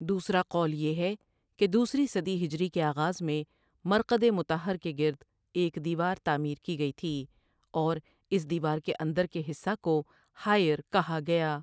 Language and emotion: Urdu, neutral